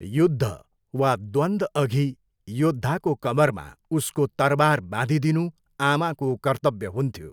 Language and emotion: Nepali, neutral